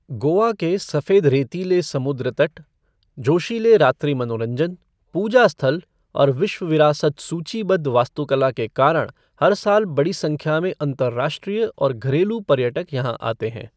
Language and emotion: Hindi, neutral